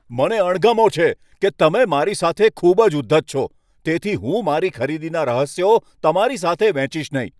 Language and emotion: Gujarati, angry